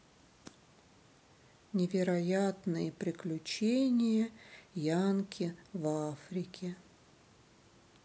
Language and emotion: Russian, sad